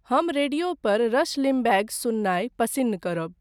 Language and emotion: Maithili, neutral